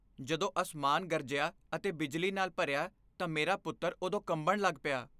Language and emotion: Punjabi, fearful